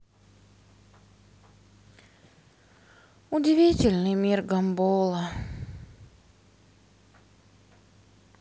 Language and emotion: Russian, sad